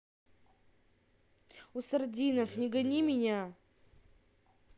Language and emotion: Russian, angry